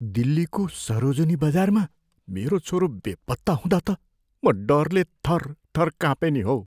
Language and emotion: Nepali, fearful